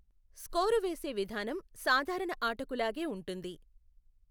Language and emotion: Telugu, neutral